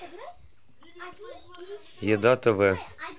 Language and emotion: Russian, neutral